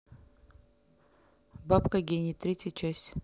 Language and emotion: Russian, neutral